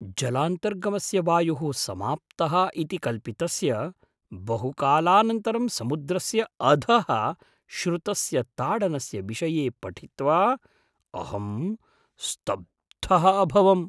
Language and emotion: Sanskrit, surprised